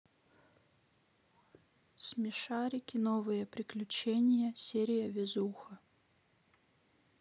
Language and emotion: Russian, neutral